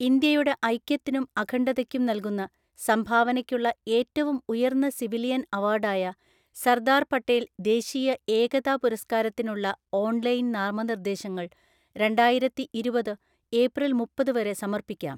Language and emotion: Malayalam, neutral